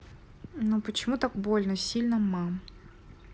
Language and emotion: Russian, neutral